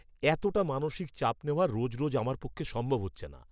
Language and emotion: Bengali, disgusted